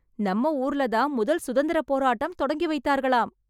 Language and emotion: Tamil, happy